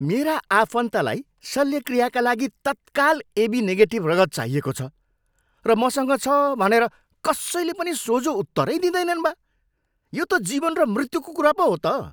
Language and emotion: Nepali, angry